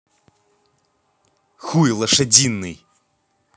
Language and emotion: Russian, angry